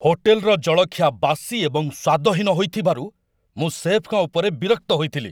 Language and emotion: Odia, angry